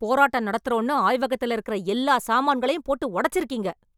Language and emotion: Tamil, angry